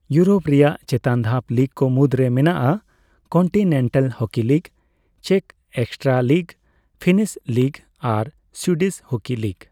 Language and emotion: Santali, neutral